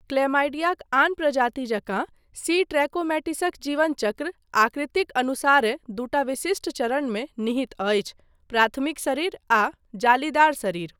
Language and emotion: Maithili, neutral